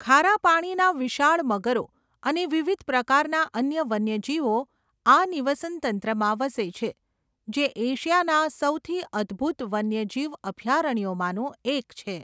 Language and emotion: Gujarati, neutral